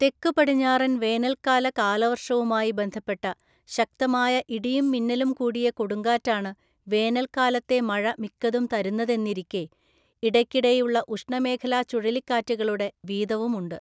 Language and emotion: Malayalam, neutral